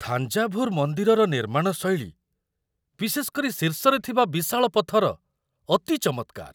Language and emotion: Odia, surprised